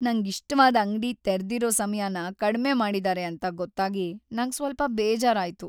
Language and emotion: Kannada, sad